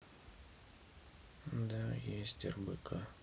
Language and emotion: Russian, neutral